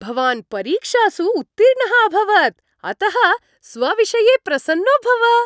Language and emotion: Sanskrit, happy